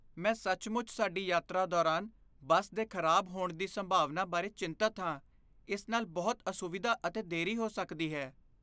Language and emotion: Punjabi, fearful